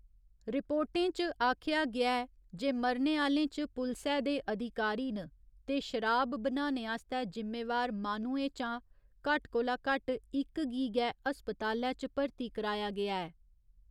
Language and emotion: Dogri, neutral